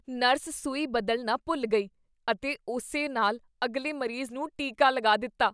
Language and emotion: Punjabi, disgusted